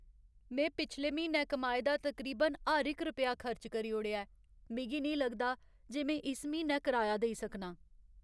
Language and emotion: Dogri, sad